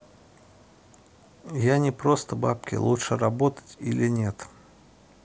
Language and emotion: Russian, neutral